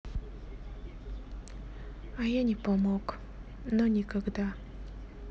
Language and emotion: Russian, sad